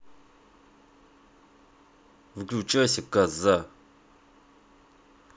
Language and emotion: Russian, angry